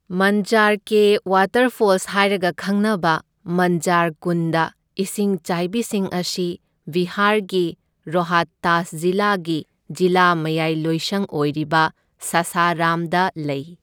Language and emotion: Manipuri, neutral